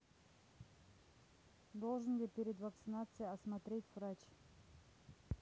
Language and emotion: Russian, neutral